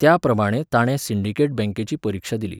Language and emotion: Goan Konkani, neutral